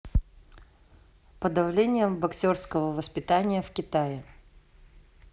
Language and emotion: Russian, neutral